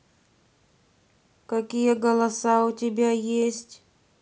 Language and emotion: Russian, neutral